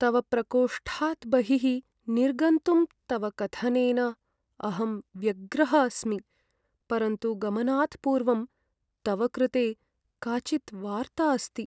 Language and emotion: Sanskrit, sad